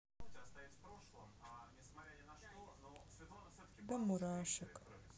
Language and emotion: Russian, sad